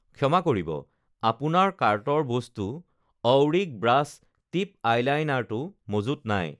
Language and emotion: Assamese, neutral